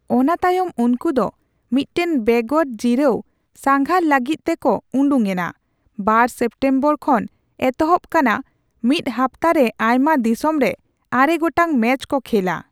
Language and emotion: Santali, neutral